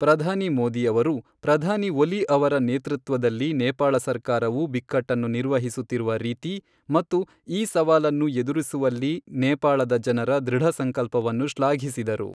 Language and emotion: Kannada, neutral